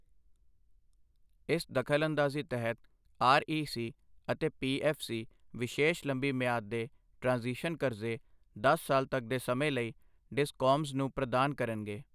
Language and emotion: Punjabi, neutral